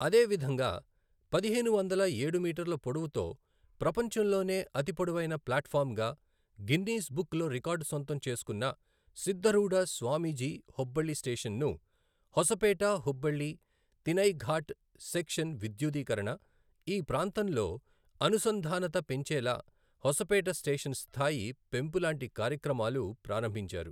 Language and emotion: Telugu, neutral